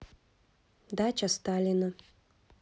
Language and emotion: Russian, neutral